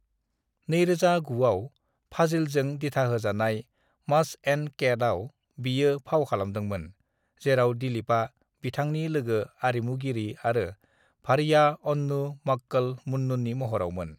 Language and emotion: Bodo, neutral